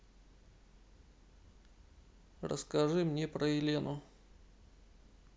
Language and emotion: Russian, neutral